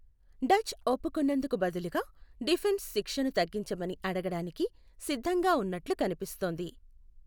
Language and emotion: Telugu, neutral